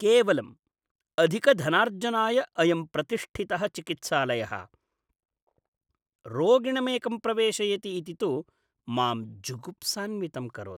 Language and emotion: Sanskrit, disgusted